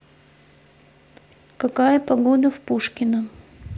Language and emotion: Russian, neutral